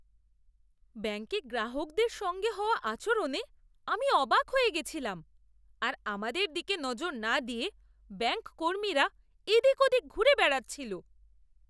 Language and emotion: Bengali, disgusted